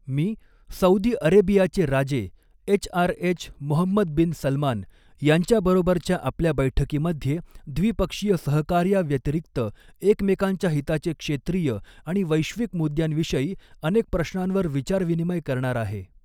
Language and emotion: Marathi, neutral